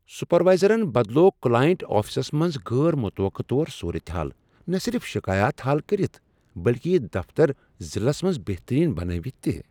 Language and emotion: Kashmiri, surprised